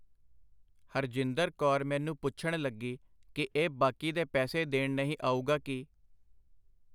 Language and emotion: Punjabi, neutral